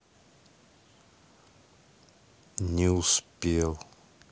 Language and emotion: Russian, sad